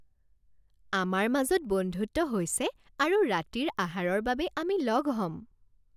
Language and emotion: Assamese, happy